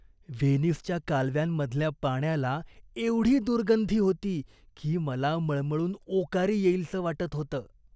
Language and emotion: Marathi, disgusted